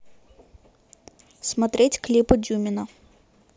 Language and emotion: Russian, neutral